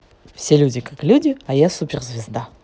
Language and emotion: Russian, positive